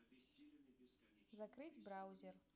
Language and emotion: Russian, neutral